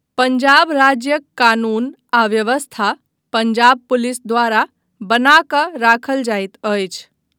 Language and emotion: Maithili, neutral